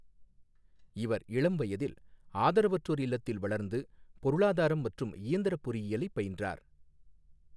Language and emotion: Tamil, neutral